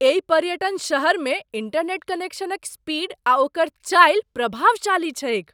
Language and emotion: Maithili, surprised